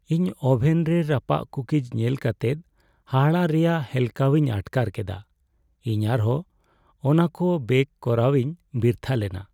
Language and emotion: Santali, sad